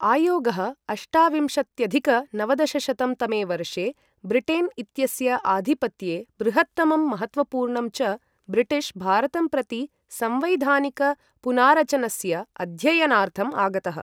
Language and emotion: Sanskrit, neutral